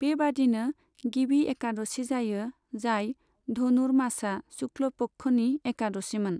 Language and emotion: Bodo, neutral